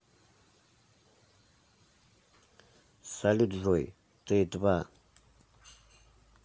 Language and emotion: Russian, neutral